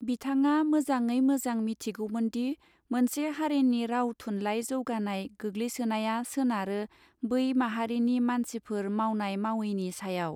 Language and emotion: Bodo, neutral